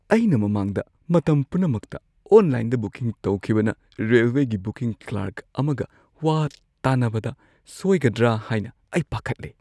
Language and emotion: Manipuri, fearful